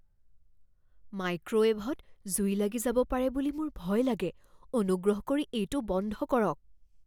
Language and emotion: Assamese, fearful